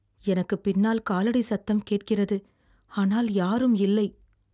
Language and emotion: Tamil, fearful